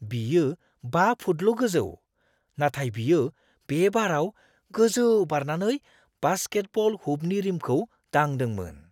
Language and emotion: Bodo, surprised